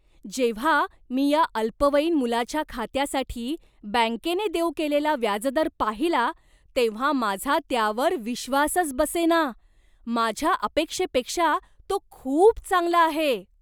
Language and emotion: Marathi, surprised